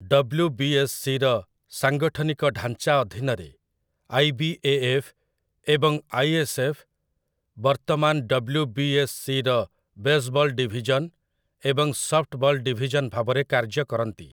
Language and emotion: Odia, neutral